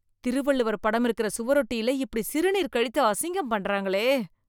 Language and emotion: Tamil, disgusted